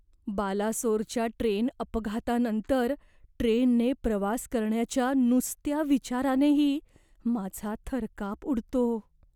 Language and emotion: Marathi, fearful